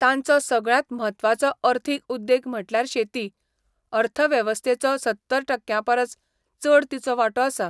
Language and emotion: Goan Konkani, neutral